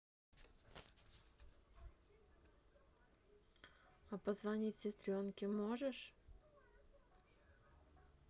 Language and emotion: Russian, neutral